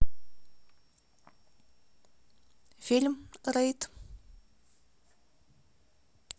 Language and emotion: Russian, neutral